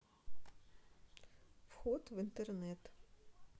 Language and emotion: Russian, neutral